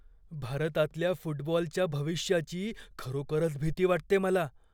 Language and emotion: Marathi, fearful